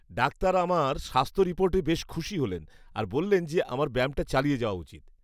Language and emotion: Bengali, happy